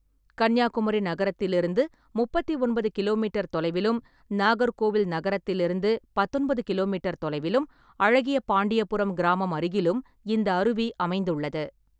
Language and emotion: Tamil, neutral